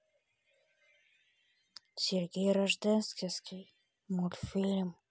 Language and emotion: Russian, neutral